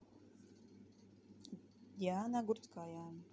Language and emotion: Russian, neutral